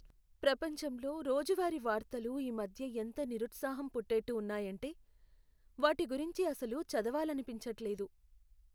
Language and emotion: Telugu, sad